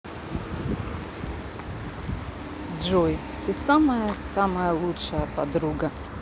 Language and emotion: Russian, positive